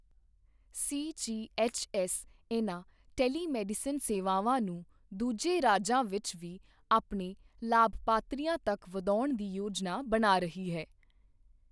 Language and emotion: Punjabi, neutral